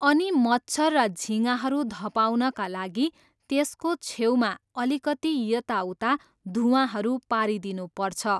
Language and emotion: Nepali, neutral